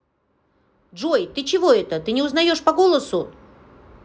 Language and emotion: Russian, angry